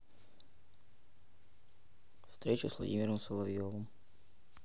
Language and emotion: Russian, neutral